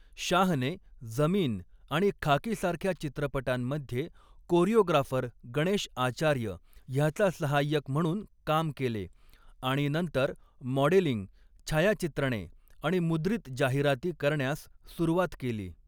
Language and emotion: Marathi, neutral